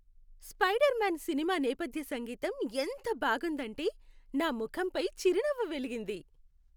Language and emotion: Telugu, happy